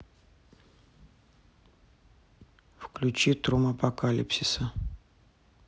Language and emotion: Russian, neutral